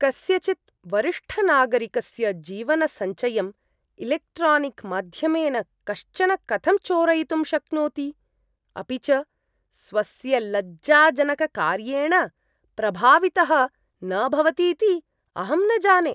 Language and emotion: Sanskrit, disgusted